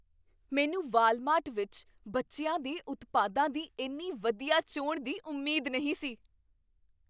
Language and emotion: Punjabi, surprised